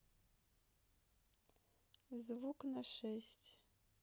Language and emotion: Russian, neutral